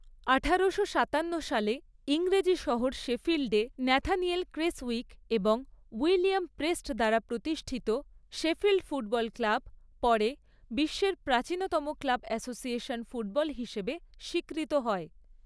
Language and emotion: Bengali, neutral